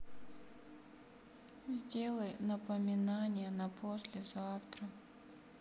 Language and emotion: Russian, sad